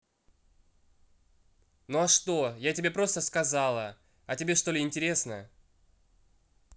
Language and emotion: Russian, angry